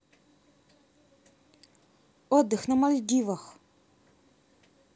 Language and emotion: Russian, neutral